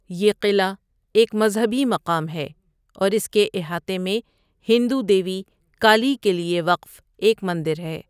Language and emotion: Urdu, neutral